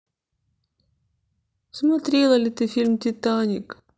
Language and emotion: Russian, sad